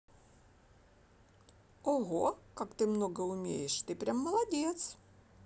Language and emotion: Russian, positive